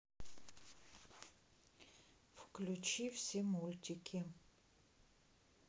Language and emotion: Russian, neutral